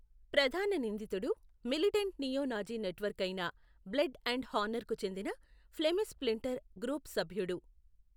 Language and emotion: Telugu, neutral